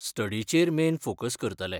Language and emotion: Goan Konkani, neutral